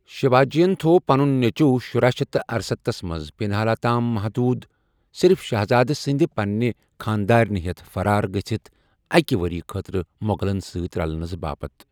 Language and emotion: Kashmiri, neutral